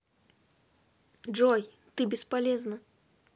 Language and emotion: Russian, neutral